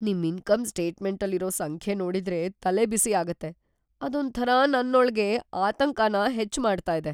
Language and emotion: Kannada, fearful